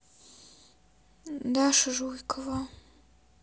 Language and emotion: Russian, sad